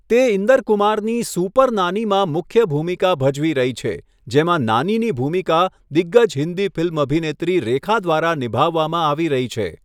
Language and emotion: Gujarati, neutral